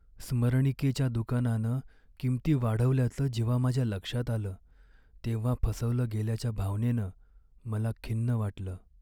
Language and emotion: Marathi, sad